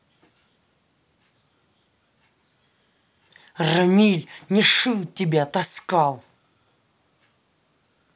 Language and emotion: Russian, angry